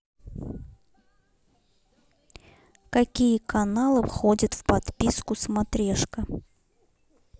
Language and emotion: Russian, neutral